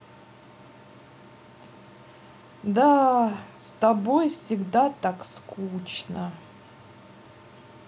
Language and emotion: Russian, sad